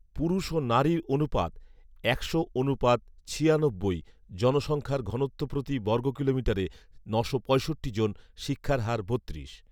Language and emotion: Bengali, neutral